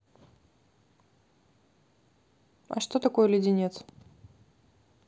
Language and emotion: Russian, neutral